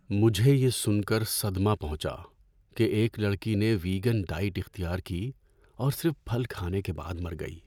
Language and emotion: Urdu, sad